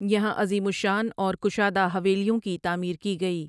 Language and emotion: Urdu, neutral